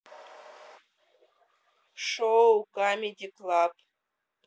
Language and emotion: Russian, neutral